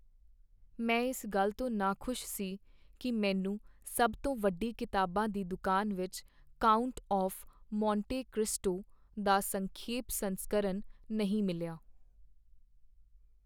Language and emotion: Punjabi, sad